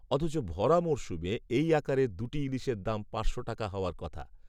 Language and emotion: Bengali, neutral